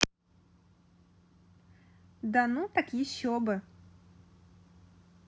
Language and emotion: Russian, positive